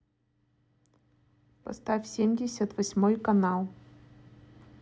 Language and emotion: Russian, neutral